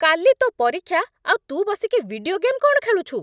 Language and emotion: Odia, angry